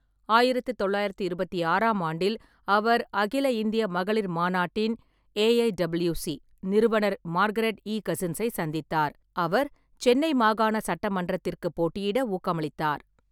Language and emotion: Tamil, neutral